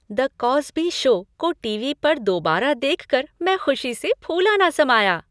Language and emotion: Hindi, happy